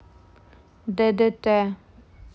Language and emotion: Russian, neutral